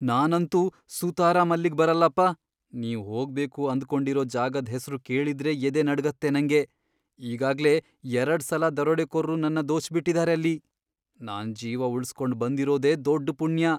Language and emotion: Kannada, fearful